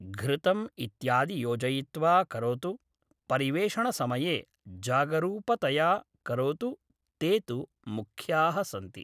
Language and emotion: Sanskrit, neutral